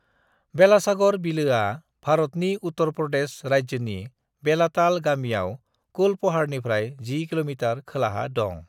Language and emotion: Bodo, neutral